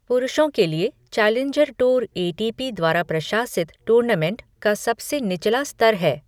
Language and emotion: Hindi, neutral